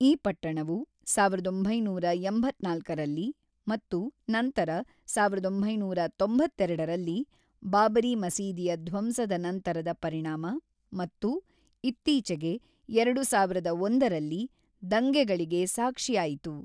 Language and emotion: Kannada, neutral